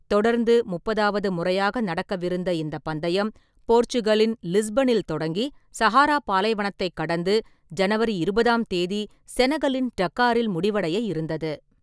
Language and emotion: Tamil, neutral